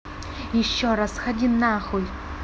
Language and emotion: Russian, angry